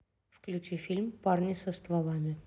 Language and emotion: Russian, neutral